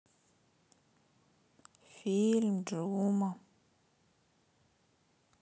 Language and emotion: Russian, sad